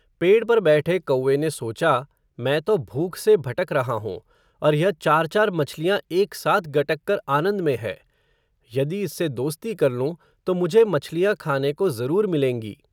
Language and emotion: Hindi, neutral